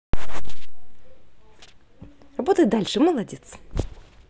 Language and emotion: Russian, positive